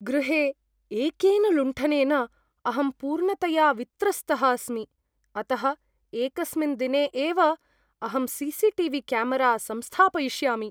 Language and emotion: Sanskrit, fearful